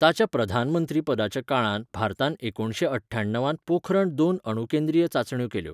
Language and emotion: Goan Konkani, neutral